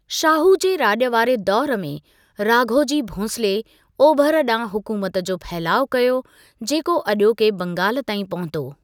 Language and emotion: Sindhi, neutral